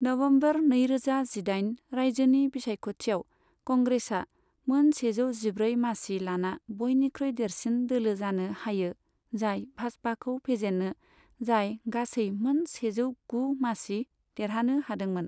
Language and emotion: Bodo, neutral